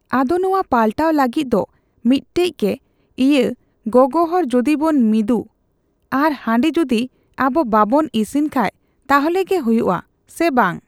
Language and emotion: Santali, neutral